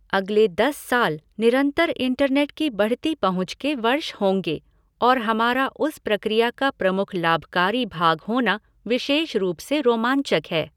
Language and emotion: Hindi, neutral